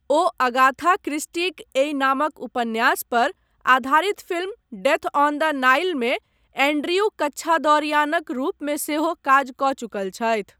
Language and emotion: Maithili, neutral